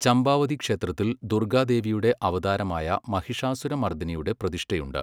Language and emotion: Malayalam, neutral